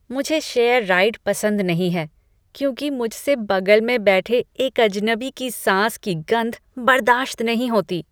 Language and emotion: Hindi, disgusted